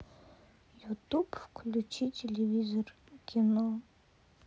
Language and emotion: Russian, sad